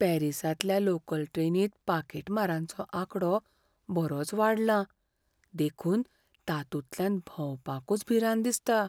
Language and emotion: Goan Konkani, fearful